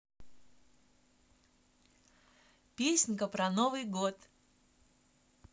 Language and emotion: Russian, positive